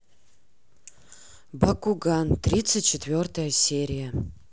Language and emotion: Russian, neutral